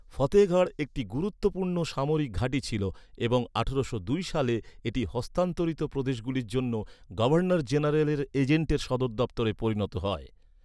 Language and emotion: Bengali, neutral